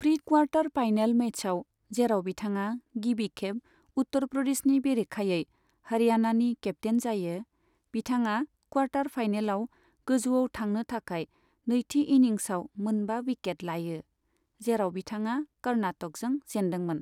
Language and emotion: Bodo, neutral